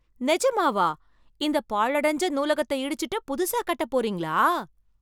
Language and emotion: Tamil, surprised